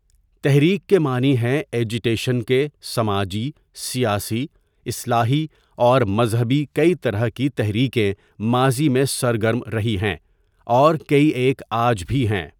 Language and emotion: Urdu, neutral